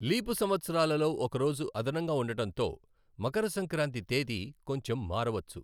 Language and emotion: Telugu, neutral